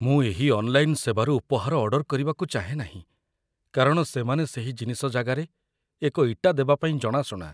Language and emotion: Odia, fearful